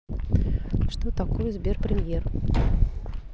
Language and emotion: Russian, neutral